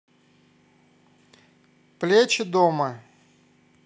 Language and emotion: Russian, neutral